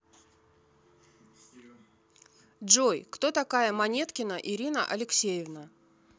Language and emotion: Russian, neutral